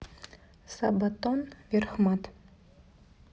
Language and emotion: Russian, neutral